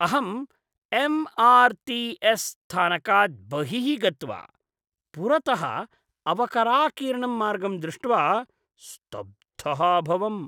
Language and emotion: Sanskrit, disgusted